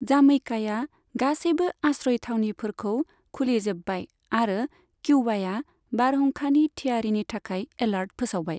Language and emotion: Bodo, neutral